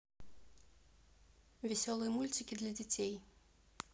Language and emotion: Russian, neutral